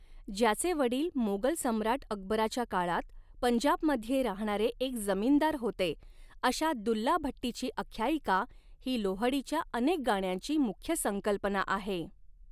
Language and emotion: Marathi, neutral